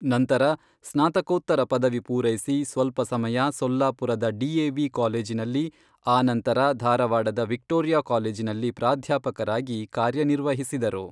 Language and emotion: Kannada, neutral